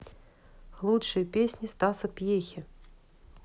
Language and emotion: Russian, neutral